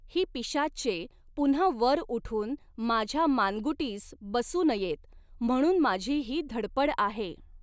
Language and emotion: Marathi, neutral